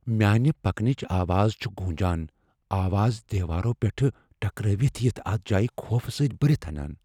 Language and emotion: Kashmiri, fearful